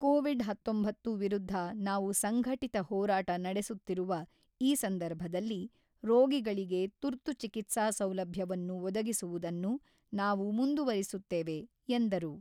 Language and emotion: Kannada, neutral